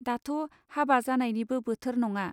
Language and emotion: Bodo, neutral